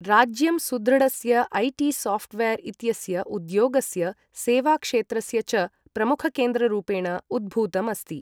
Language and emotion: Sanskrit, neutral